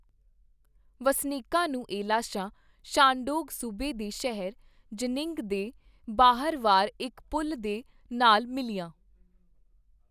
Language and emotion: Punjabi, neutral